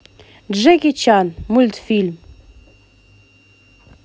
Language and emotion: Russian, positive